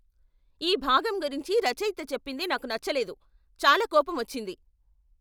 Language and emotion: Telugu, angry